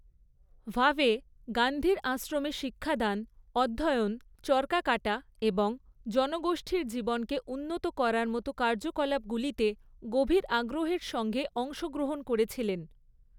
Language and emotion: Bengali, neutral